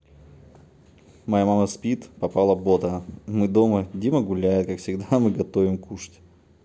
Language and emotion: Russian, neutral